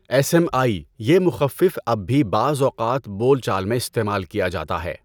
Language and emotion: Urdu, neutral